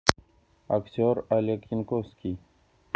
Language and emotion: Russian, neutral